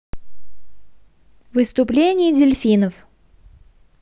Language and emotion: Russian, positive